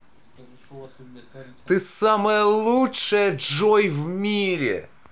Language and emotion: Russian, positive